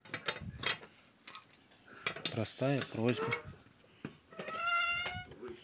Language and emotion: Russian, neutral